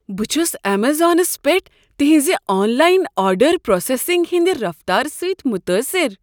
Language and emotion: Kashmiri, surprised